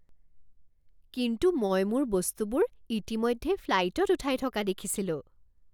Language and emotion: Assamese, surprised